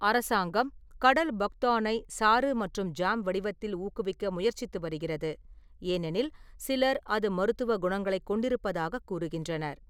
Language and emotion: Tamil, neutral